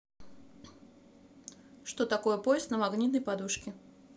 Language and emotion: Russian, neutral